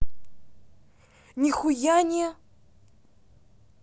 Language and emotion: Russian, angry